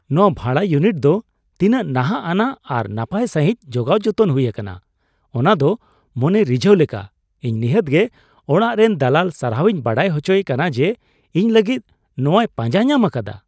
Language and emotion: Santali, surprised